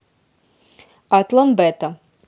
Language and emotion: Russian, neutral